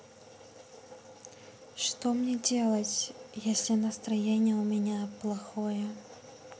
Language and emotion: Russian, sad